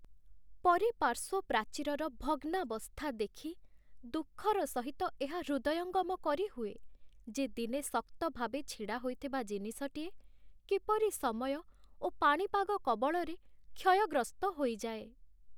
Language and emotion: Odia, sad